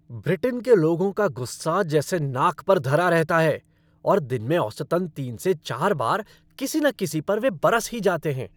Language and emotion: Hindi, angry